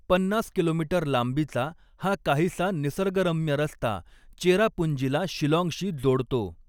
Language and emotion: Marathi, neutral